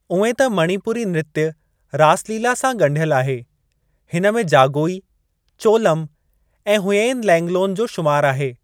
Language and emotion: Sindhi, neutral